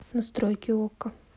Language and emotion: Russian, neutral